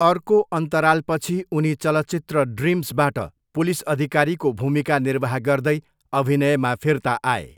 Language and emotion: Nepali, neutral